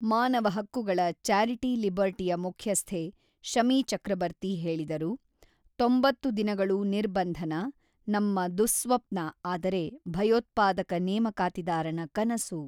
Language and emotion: Kannada, neutral